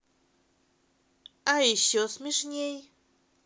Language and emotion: Russian, positive